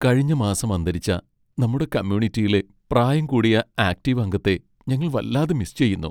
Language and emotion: Malayalam, sad